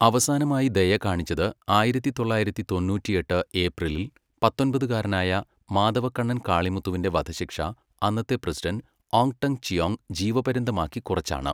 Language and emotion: Malayalam, neutral